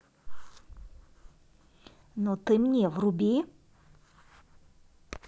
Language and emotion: Russian, angry